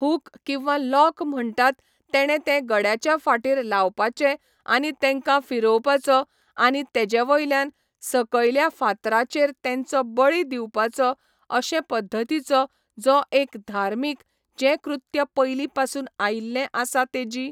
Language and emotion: Goan Konkani, neutral